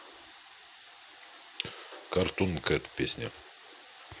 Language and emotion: Russian, neutral